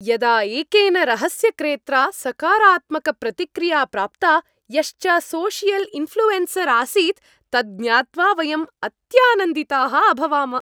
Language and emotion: Sanskrit, happy